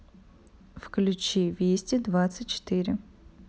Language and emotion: Russian, neutral